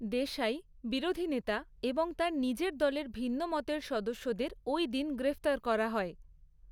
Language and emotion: Bengali, neutral